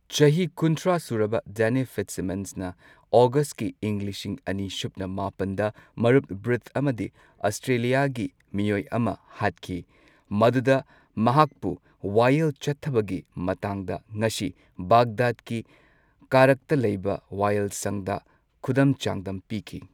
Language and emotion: Manipuri, neutral